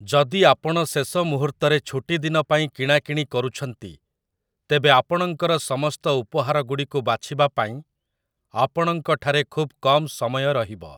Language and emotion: Odia, neutral